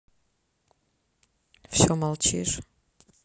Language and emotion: Russian, neutral